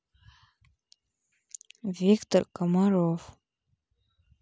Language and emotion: Russian, neutral